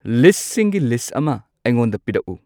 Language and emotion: Manipuri, neutral